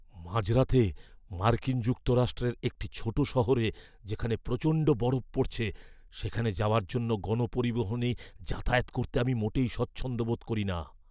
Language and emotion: Bengali, fearful